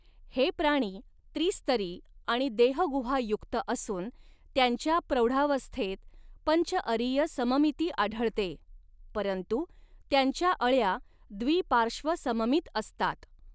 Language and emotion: Marathi, neutral